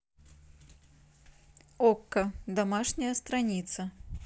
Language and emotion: Russian, neutral